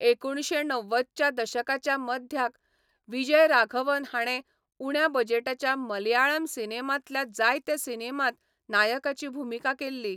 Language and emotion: Goan Konkani, neutral